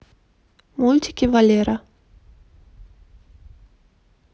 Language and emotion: Russian, neutral